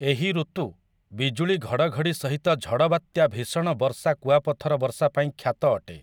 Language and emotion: Odia, neutral